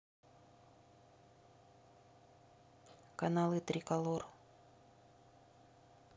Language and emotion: Russian, neutral